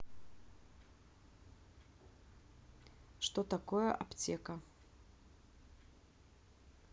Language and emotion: Russian, neutral